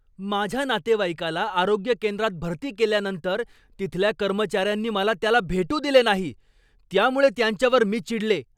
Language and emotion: Marathi, angry